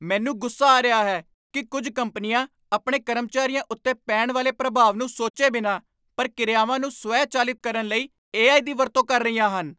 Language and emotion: Punjabi, angry